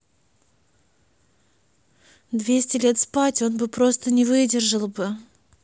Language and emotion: Russian, neutral